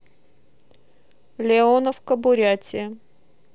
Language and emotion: Russian, neutral